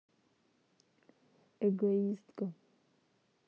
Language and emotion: Russian, neutral